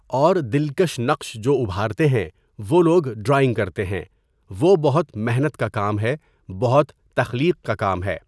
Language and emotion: Urdu, neutral